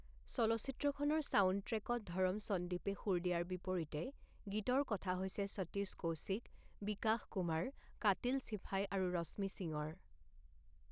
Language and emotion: Assamese, neutral